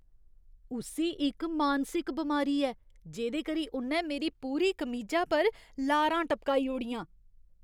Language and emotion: Dogri, disgusted